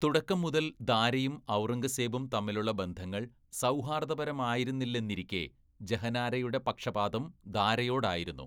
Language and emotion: Malayalam, neutral